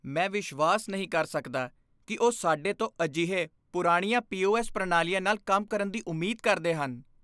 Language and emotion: Punjabi, disgusted